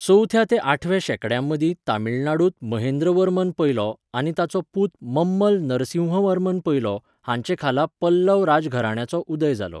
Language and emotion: Goan Konkani, neutral